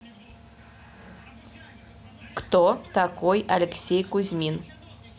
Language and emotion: Russian, neutral